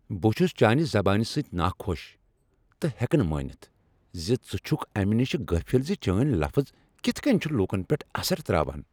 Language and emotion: Kashmiri, angry